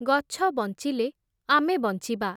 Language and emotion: Odia, neutral